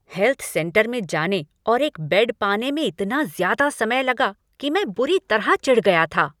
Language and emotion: Hindi, angry